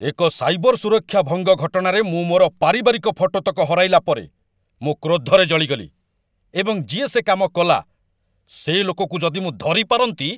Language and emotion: Odia, angry